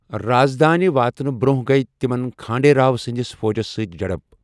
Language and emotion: Kashmiri, neutral